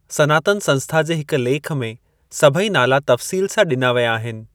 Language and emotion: Sindhi, neutral